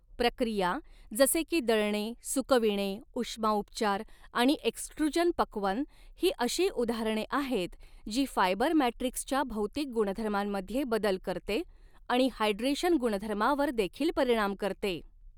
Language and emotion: Marathi, neutral